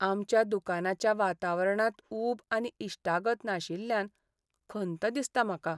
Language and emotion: Goan Konkani, sad